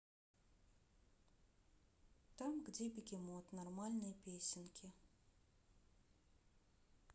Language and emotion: Russian, neutral